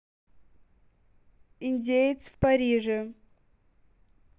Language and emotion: Russian, neutral